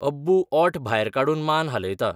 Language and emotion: Goan Konkani, neutral